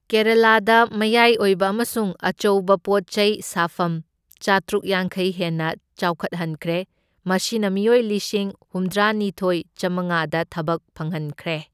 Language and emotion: Manipuri, neutral